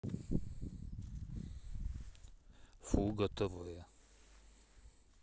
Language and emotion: Russian, neutral